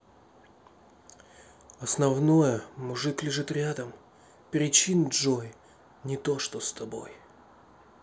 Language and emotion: Russian, neutral